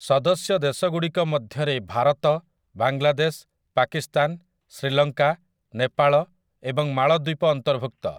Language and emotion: Odia, neutral